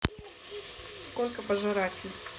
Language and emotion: Russian, neutral